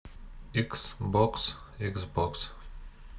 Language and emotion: Russian, neutral